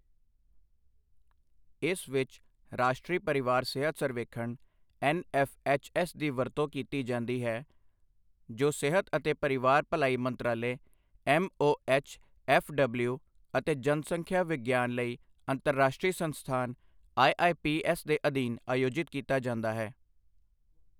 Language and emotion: Punjabi, neutral